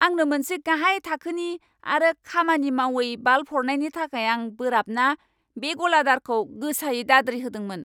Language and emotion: Bodo, angry